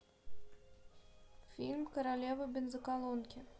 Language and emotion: Russian, neutral